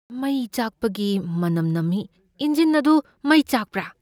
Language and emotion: Manipuri, fearful